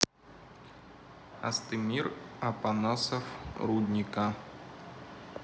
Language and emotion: Russian, neutral